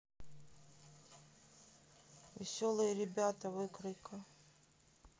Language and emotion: Russian, sad